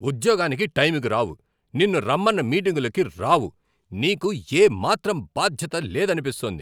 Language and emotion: Telugu, angry